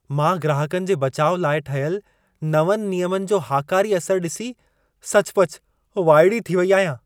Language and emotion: Sindhi, surprised